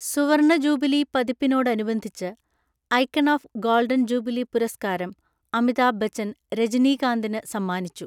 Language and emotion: Malayalam, neutral